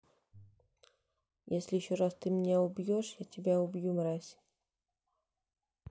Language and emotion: Russian, neutral